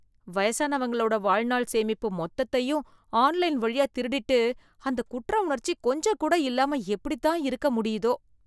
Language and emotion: Tamil, disgusted